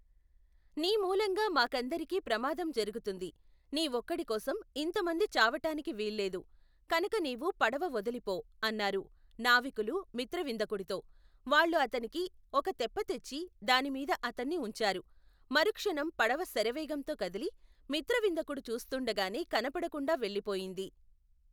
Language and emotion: Telugu, neutral